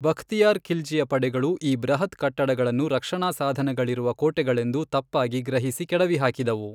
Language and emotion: Kannada, neutral